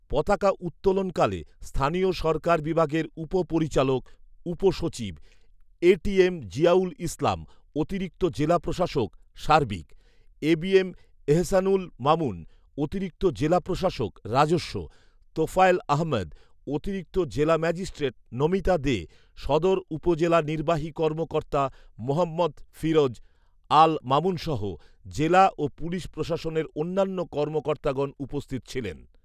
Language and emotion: Bengali, neutral